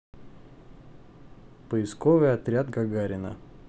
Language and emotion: Russian, neutral